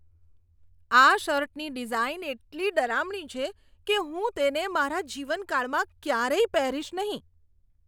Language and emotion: Gujarati, disgusted